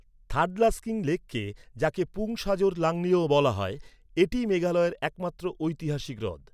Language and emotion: Bengali, neutral